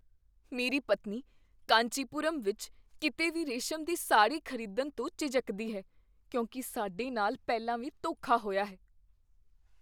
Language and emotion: Punjabi, fearful